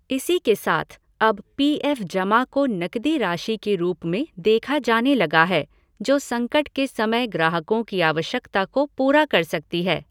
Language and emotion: Hindi, neutral